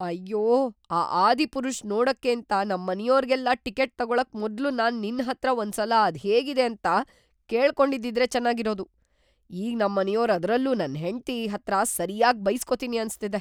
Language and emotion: Kannada, fearful